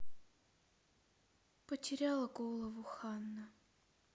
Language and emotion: Russian, sad